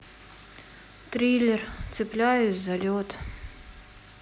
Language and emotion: Russian, sad